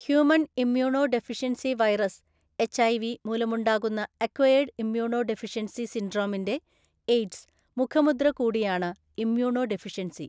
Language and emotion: Malayalam, neutral